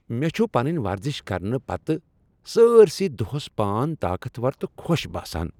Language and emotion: Kashmiri, happy